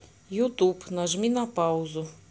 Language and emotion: Russian, neutral